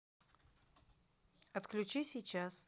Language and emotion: Russian, neutral